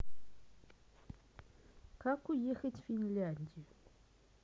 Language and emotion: Russian, neutral